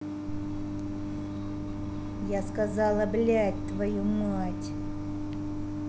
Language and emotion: Russian, angry